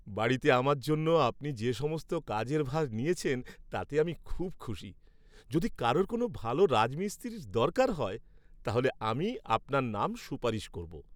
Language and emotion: Bengali, happy